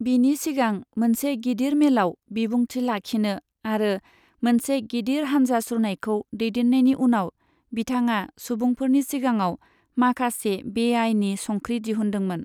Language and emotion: Bodo, neutral